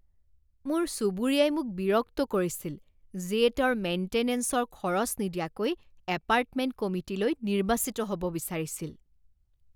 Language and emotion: Assamese, disgusted